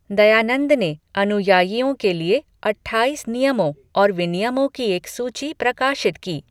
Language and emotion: Hindi, neutral